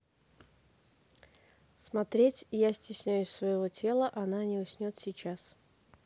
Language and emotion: Russian, neutral